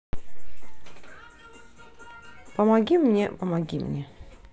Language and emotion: Russian, neutral